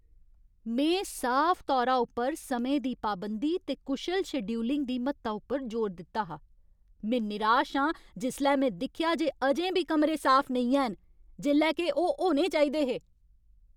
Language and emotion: Dogri, angry